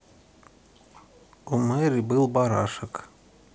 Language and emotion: Russian, neutral